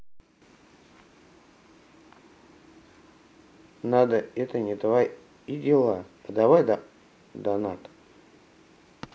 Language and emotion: Russian, neutral